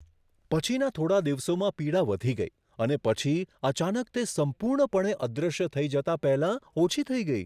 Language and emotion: Gujarati, surprised